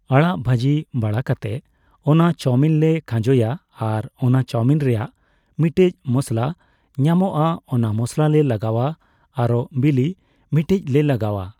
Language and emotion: Santali, neutral